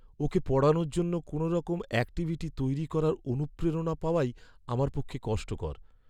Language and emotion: Bengali, sad